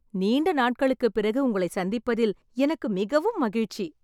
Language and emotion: Tamil, happy